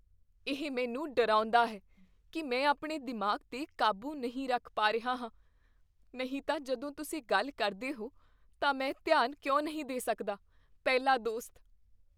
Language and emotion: Punjabi, fearful